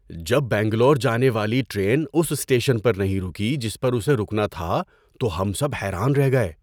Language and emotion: Urdu, surprised